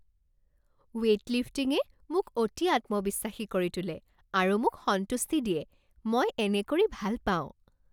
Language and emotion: Assamese, happy